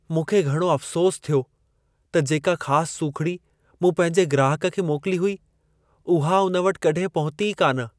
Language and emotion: Sindhi, sad